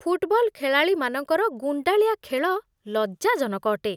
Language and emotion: Odia, disgusted